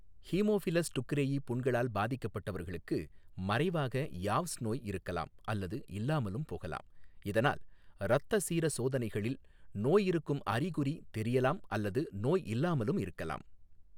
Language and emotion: Tamil, neutral